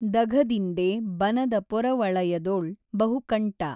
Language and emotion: Kannada, neutral